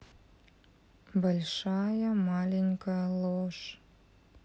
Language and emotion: Russian, neutral